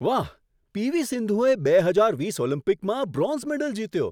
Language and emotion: Gujarati, surprised